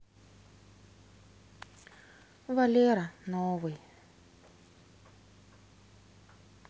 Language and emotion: Russian, sad